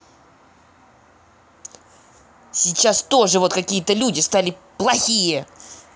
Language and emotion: Russian, angry